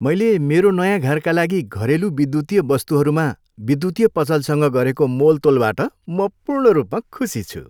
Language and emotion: Nepali, happy